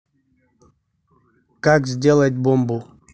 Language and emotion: Russian, neutral